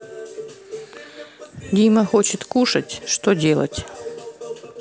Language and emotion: Russian, neutral